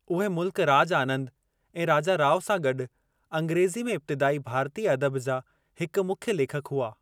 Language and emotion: Sindhi, neutral